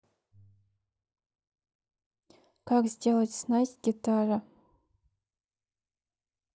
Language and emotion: Russian, neutral